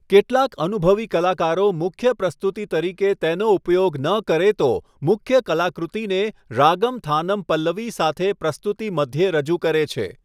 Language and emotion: Gujarati, neutral